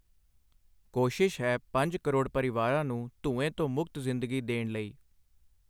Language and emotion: Punjabi, neutral